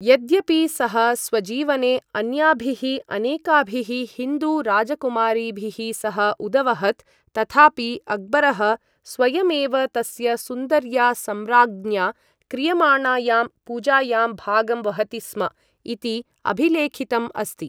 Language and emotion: Sanskrit, neutral